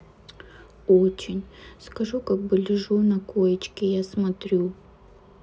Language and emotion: Russian, sad